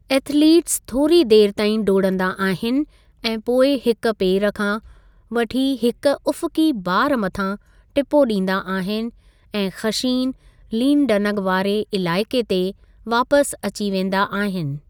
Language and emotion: Sindhi, neutral